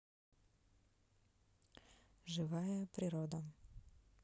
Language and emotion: Russian, neutral